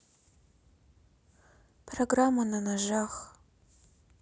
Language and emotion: Russian, sad